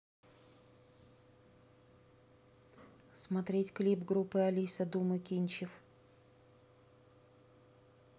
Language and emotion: Russian, neutral